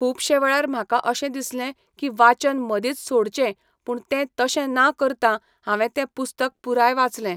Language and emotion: Goan Konkani, neutral